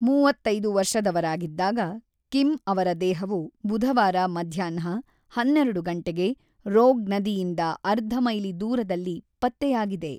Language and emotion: Kannada, neutral